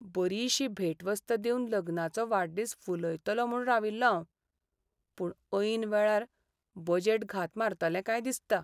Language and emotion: Goan Konkani, sad